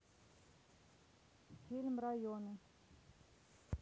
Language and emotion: Russian, neutral